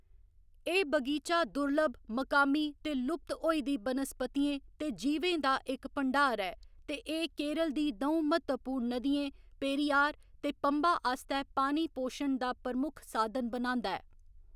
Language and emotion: Dogri, neutral